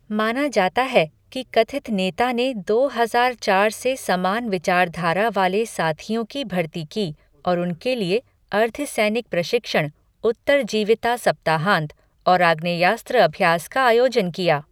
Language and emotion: Hindi, neutral